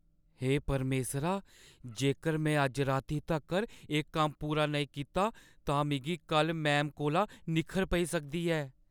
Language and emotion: Dogri, fearful